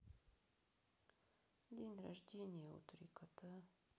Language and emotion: Russian, sad